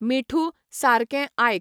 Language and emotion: Goan Konkani, neutral